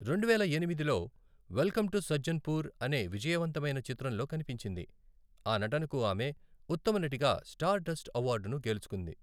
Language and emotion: Telugu, neutral